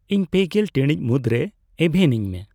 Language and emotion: Santali, neutral